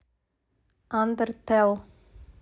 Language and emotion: Russian, neutral